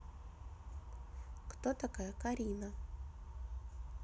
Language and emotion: Russian, neutral